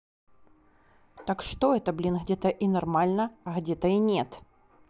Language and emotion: Russian, angry